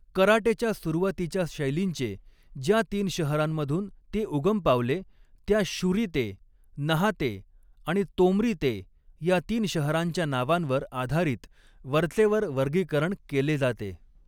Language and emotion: Marathi, neutral